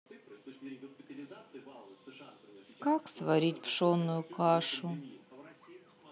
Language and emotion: Russian, sad